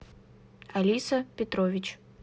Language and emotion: Russian, neutral